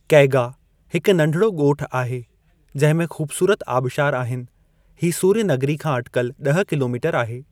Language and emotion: Sindhi, neutral